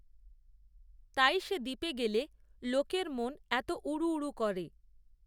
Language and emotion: Bengali, neutral